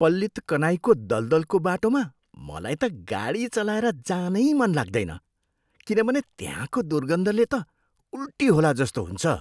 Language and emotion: Nepali, disgusted